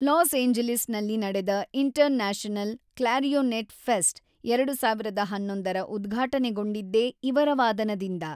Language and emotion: Kannada, neutral